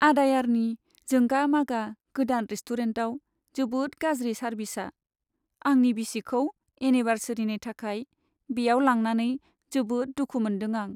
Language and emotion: Bodo, sad